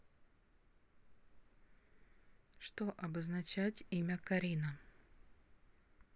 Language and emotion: Russian, neutral